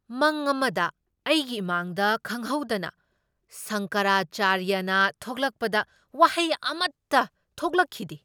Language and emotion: Manipuri, surprised